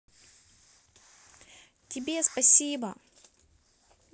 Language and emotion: Russian, positive